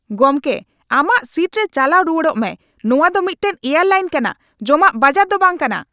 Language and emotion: Santali, angry